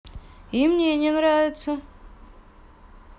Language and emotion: Russian, neutral